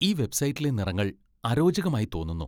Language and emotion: Malayalam, disgusted